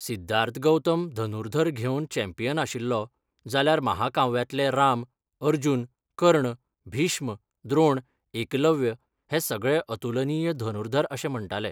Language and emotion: Goan Konkani, neutral